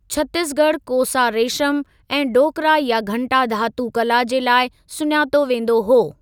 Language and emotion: Sindhi, neutral